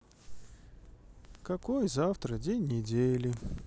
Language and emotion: Russian, sad